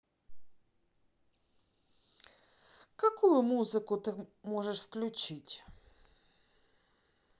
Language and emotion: Russian, neutral